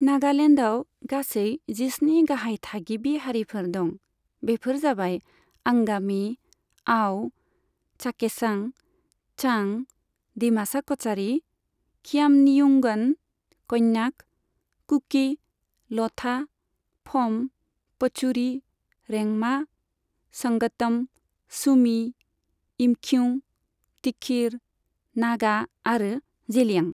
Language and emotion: Bodo, neutral